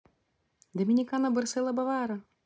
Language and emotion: Russian, positive